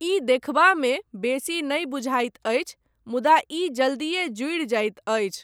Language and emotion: Maithili, neutral